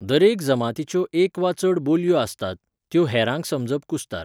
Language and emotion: Goan Konkani, neutral